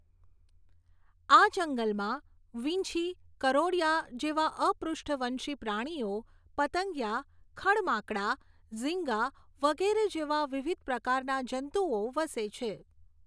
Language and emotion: Gujarati, neutral